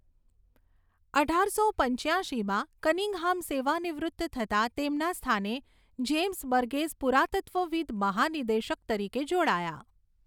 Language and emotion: Gujarati, neutral